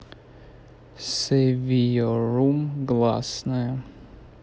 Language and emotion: Russian, neutral